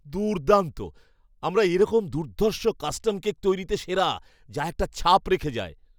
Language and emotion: Bengali, surprised